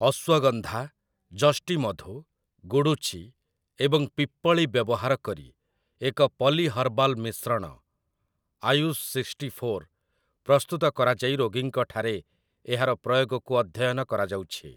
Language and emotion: Odia, neutral